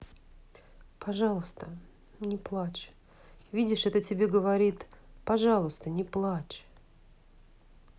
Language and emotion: Russian, sad